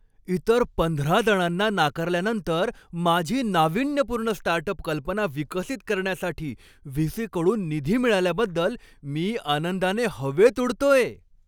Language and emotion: Marathi, happy